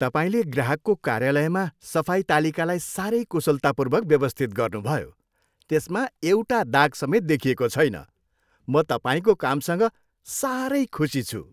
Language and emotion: Nepali, happy